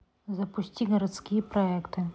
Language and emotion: Russian, neutral